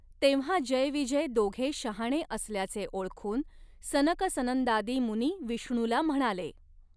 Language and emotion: Marathi, neutral